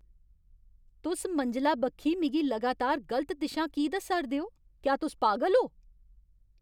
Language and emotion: Dogri, angry